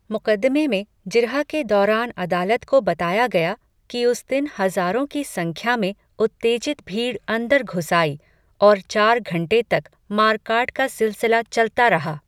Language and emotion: Hindi, neutral